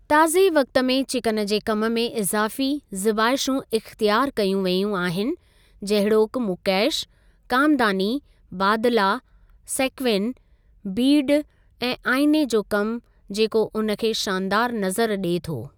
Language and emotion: Sindhi, neutral